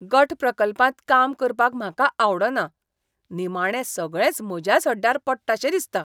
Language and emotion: Goan Konkani, disgusted